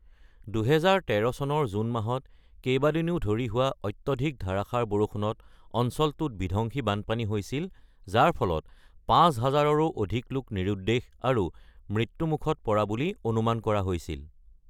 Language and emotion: Assamese, neutral